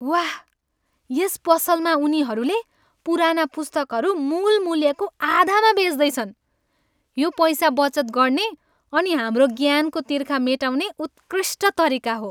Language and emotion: Nepali, happy